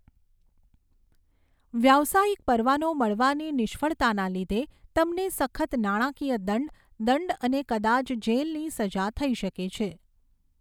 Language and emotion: Gujarati, neutral